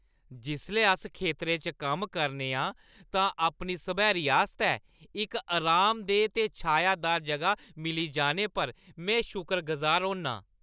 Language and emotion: Dogri, happy